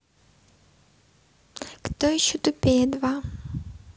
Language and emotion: Russian, neutral